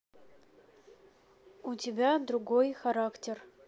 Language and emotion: Russian, neutral